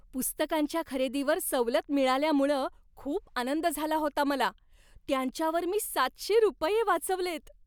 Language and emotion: Marathi, happy